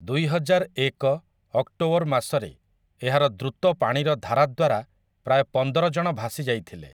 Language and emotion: Odia, neutral